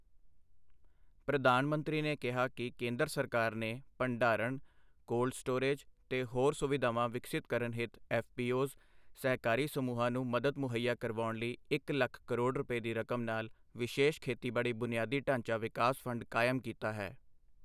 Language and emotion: Punjabi, neutral